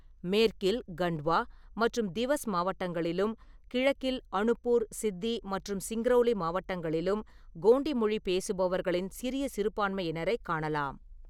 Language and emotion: Tamil, neutral